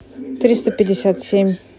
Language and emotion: Russian, neutral